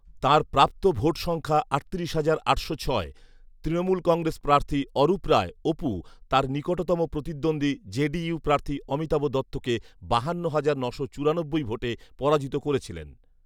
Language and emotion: Bengali, neutral